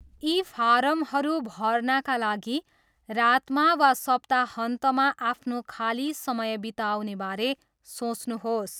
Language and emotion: Nepali, neutral